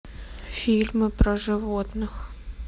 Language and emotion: Russian, sad